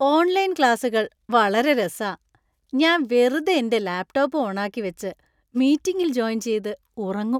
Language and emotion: Malayalam, happy